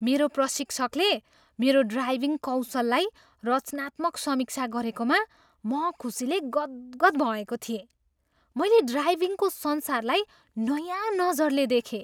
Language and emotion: Nepali, surprised